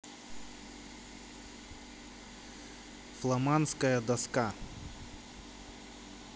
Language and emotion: Russian, neutral